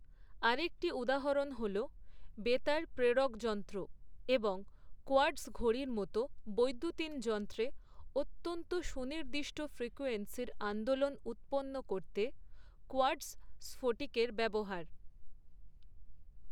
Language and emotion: Bengali, neutral